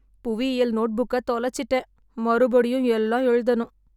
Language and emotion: Tamil, sad